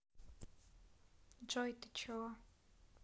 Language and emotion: Russian, neutral